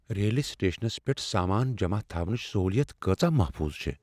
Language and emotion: Kashmiri, fearful